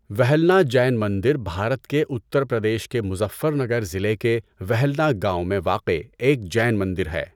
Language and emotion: Urdu, neutral